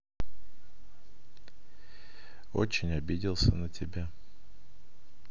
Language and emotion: Russian, sad